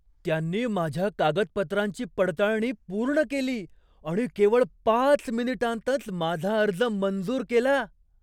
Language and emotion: Marathi, surprised